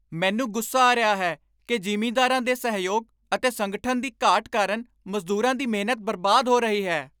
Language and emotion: Punjabi, angry